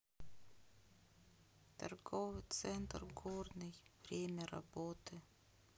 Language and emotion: Russian, sad